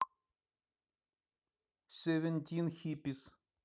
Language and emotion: Russian, neutral